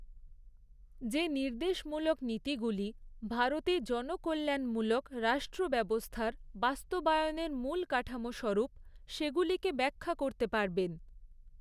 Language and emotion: Bengali, neutral